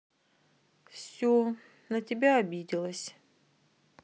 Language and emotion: Russian, sad